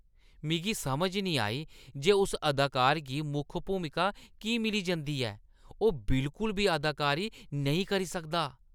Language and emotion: Dogri, disgusted